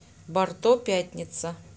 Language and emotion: Russian, neutral